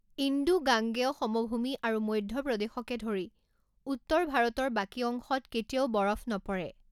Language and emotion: Assamese, neutral